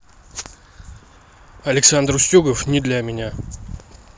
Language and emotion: Russian, neutral